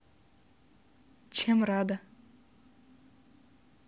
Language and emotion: Russian, neutral